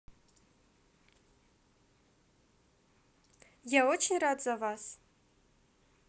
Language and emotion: Russian, positive